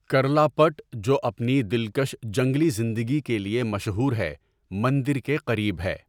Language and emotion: Urdu, neutral